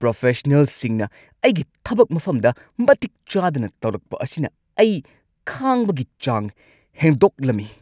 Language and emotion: Manipuri, angry